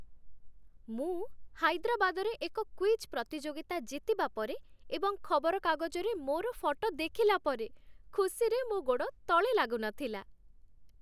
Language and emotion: Odia, happy